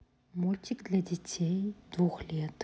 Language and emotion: Russian, neutral